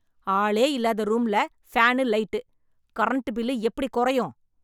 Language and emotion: Tamil, angry